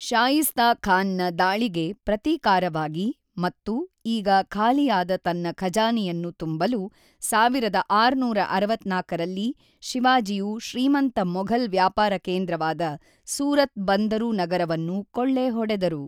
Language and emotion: Kannada, neutral